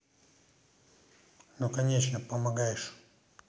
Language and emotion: Russian, neutral